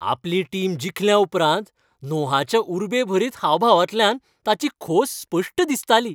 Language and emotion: Goan Konkani, happy